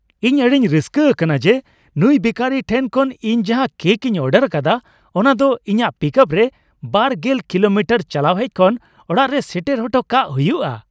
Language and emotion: Santali, happy